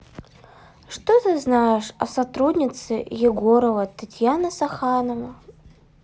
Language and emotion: Russian, sad